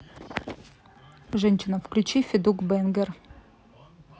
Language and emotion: Russian, neutral